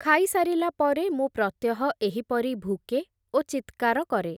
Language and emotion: Odia, neutral